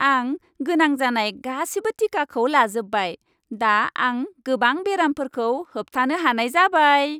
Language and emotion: Bodo, happy